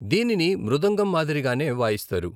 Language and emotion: Telugu, neutral